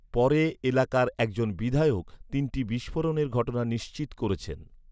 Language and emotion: Bengali, neutral